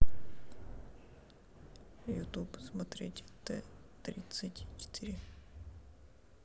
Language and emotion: Russian, sad